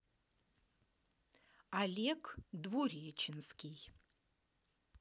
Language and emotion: Russian, positive